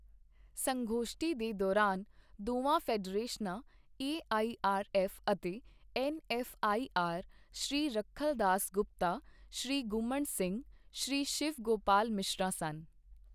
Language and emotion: Punjabi, neutral